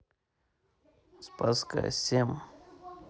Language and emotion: Russian, neutral